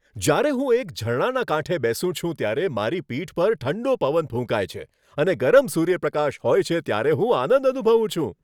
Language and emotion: Gujarati, happy